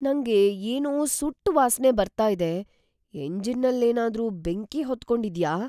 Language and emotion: Kannada, fearful